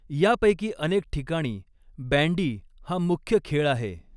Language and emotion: Marathi, neutral